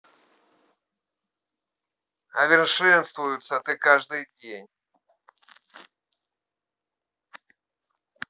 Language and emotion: Russian, angry